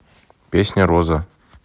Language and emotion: Russian, neutral